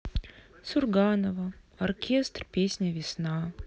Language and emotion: Russian, sad